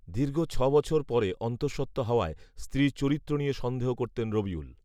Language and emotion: Bengali, neutral